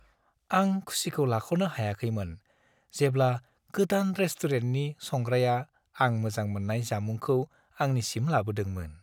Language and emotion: Bodo, happy